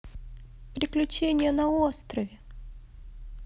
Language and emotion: Russian, positive